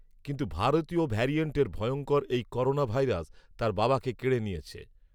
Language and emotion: Bengali, neutral